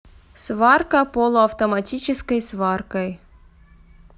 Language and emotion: Russian, neutral